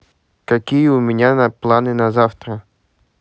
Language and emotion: Russian, neutral